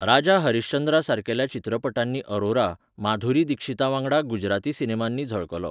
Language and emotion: Goan Konkani, neutral